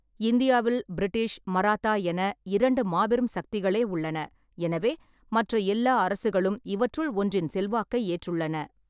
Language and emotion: Tamil, neutral